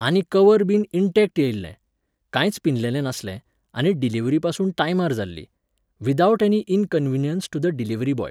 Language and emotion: Goan Konkani, neutral